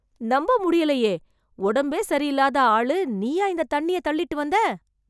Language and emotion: Tamil, surprised